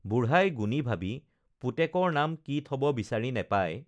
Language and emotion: Assamese, neutral